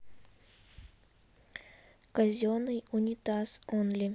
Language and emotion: Russian, neutral